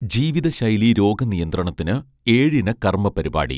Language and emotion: Malayalam, neutral